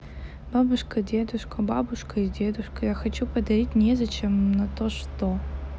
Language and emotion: Russian, neutral